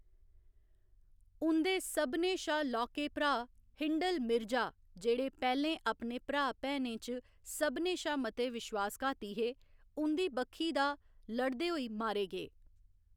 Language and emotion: Dogri, neutral